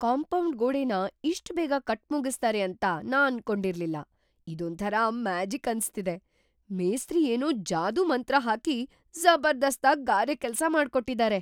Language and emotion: Kannada, surprised